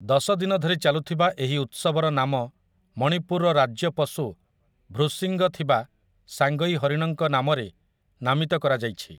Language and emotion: Odia, neutral